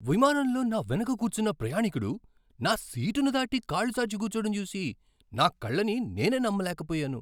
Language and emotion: Telugu, surprised